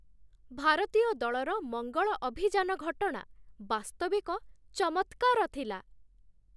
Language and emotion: Odia, surprised